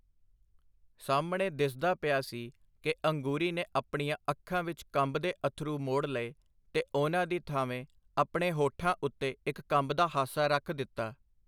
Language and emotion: Punjabi, neutral